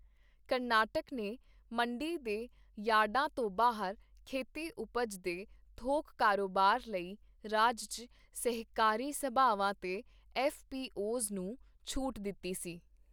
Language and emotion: Punjabi, neutral